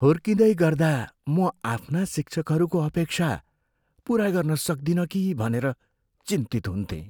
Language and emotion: Nepali, fearful